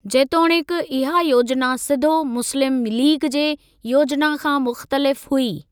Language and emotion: Sindhi, neutral